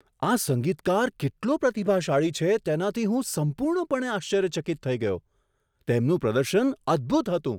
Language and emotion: Gujarati, surprised